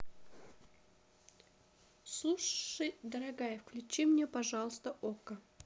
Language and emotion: Russian, neutral